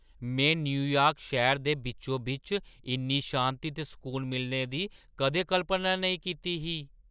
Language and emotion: Dogri, surprised